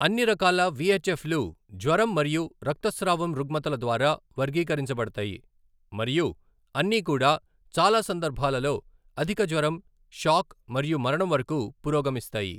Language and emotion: Telugu, neutral